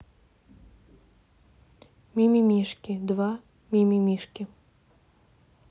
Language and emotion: Russian, neutral